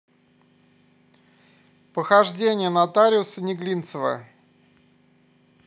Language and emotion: Russian, neutral